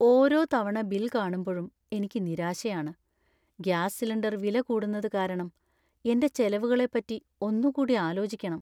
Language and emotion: Malayalam, sad